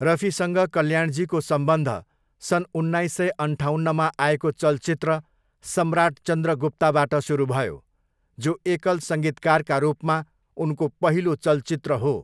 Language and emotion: Nepali, neutral